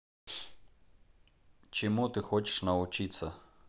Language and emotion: Russian, neutral